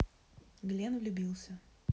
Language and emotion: Russian, neutral